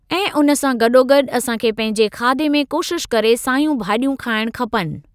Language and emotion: Sindhi, neutral